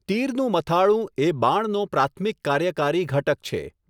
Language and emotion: Gujarati, neutral